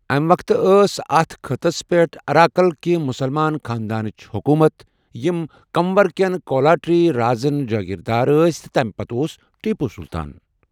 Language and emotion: Kashmiri, neutral